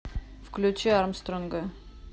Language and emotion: Russian, neutral